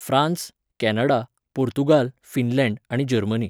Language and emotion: Goan Konkani, neutral